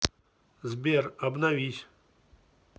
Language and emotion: Russian, neutral